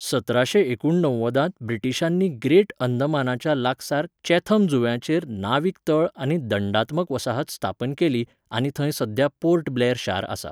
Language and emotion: Goan Konkani, neutral